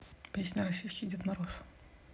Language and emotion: Russian, neutral